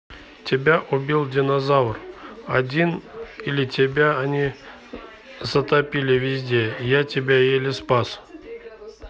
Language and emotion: Russian, neutral